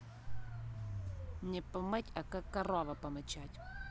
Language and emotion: Russian, angry